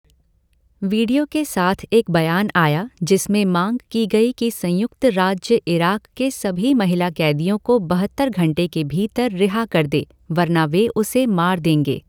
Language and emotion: Hindi, neutral